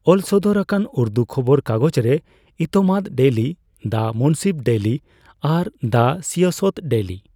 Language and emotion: Santali, neutral